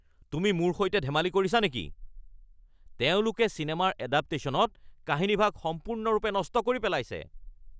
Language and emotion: Assamese, angry